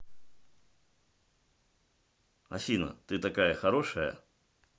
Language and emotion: Russian, positive